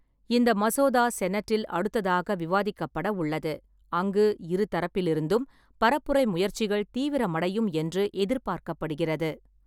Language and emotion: Tamil, neutral